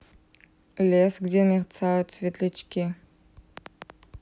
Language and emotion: Russian, neutral